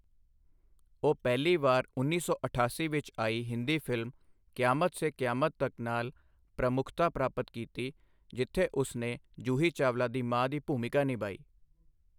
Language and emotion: Punjabi, neutral